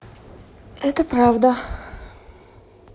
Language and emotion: Russian, neutral